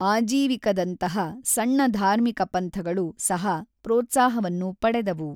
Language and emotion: Kannada, neutral